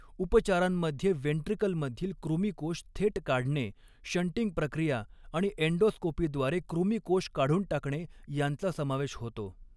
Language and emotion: Marathi, neutral